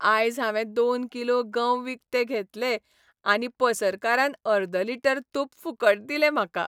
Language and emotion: Goan Konkani, happy